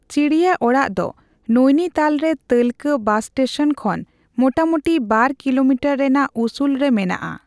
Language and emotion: Santali, neutral